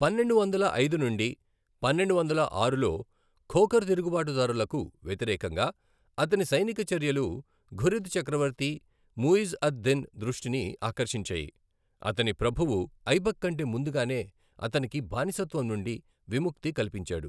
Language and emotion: Telugu, neutral